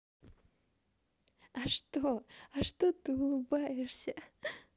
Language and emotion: Russian, positive